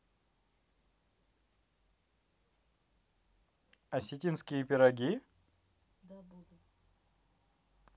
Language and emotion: Russian, positive